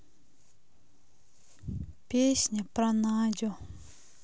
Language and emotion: Russian, sad